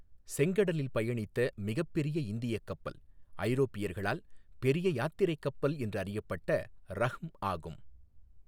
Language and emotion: Tamil, neutral